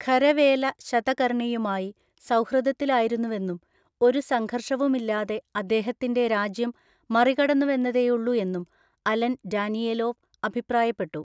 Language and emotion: Malayalam, neutral